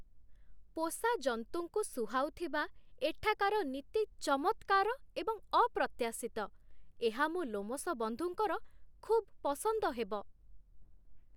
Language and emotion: Odia, surprised